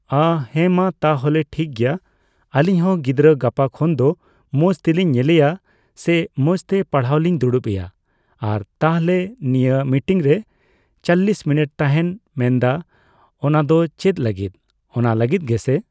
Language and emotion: Santali, neutral